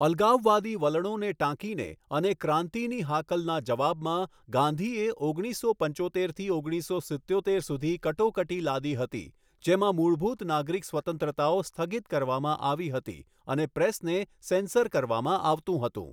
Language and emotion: Gujarati, neutral